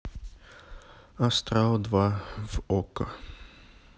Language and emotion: Russian, neutral